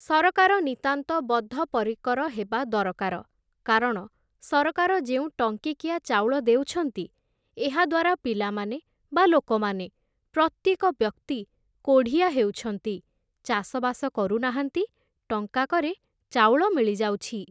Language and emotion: Odia, neutral